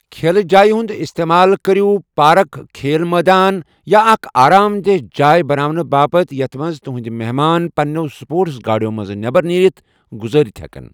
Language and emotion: Kashmiri, neutral